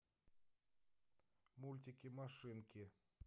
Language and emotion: Russian, neutral